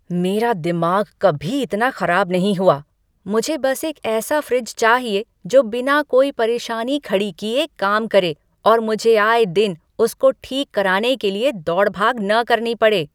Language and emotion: Hindi, angry